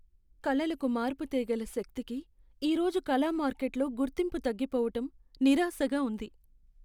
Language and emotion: Telugu, sad